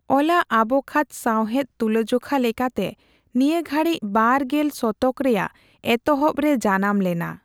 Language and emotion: Santali, neutral